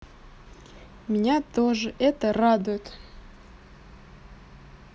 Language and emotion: Russian, positive